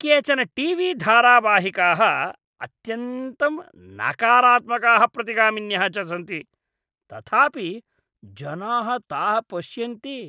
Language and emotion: Sanskrit, disgusted